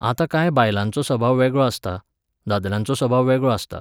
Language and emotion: Goan Konkani, neutral